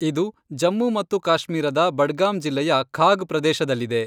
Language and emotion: Kannada, neutral